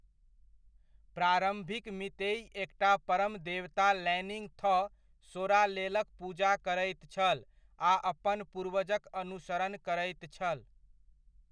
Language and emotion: Maithili, neutral